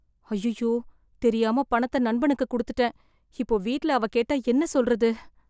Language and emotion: Tamil, fearful